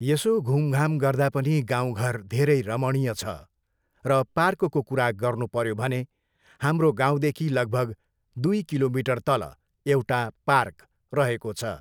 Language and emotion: Nepali, neutral